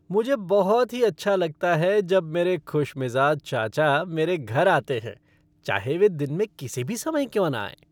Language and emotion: Hindi, happy